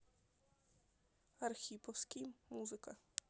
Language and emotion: Russian, neutral